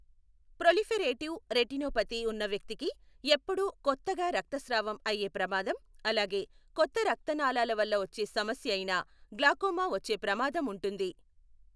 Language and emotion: Telugu, neutral